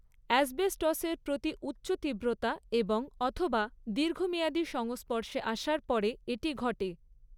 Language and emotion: Bengali, neutral